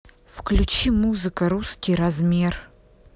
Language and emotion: Russian, neutral